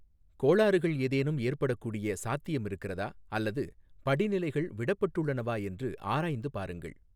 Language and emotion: Tamil, neutral